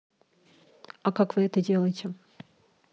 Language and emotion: Russian, neutral